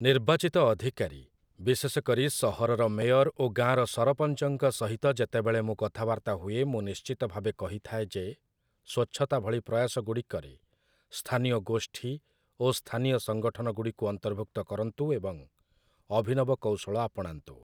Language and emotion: Odia, neutral